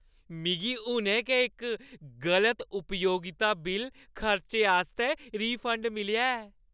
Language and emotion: Dogri, happy